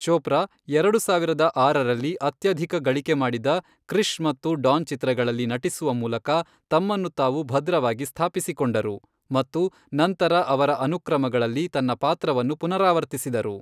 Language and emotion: Kannada, neutral